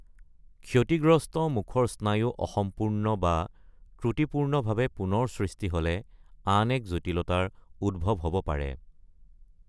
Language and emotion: Assamese, neutral